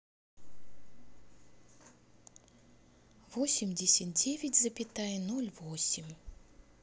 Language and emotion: Russian, neutral